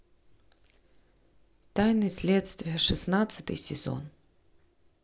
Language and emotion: Russian, neutral